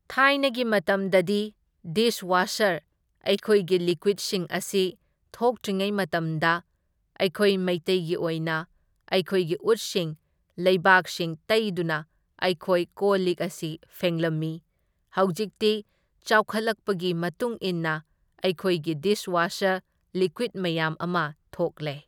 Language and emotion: Manipuri, neutral